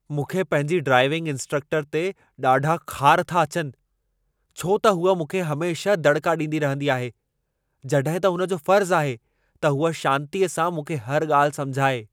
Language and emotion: Sindhi, angry